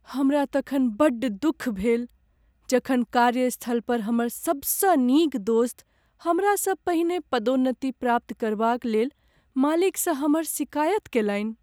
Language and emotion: Maithili, sad